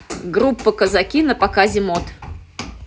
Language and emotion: Russian, neutral